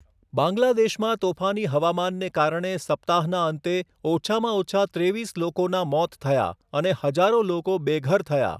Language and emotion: Gujarati, neutral